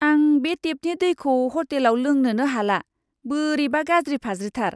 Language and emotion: Bodo, disgusted